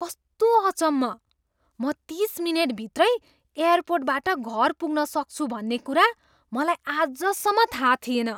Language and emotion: Nepali, surprised